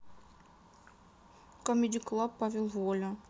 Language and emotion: Russian, sad